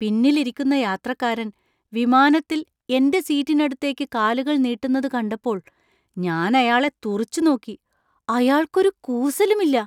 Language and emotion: Malayalam, surprised